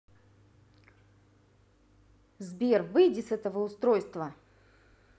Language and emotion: Russian, angry